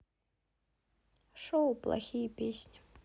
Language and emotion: Russian, sad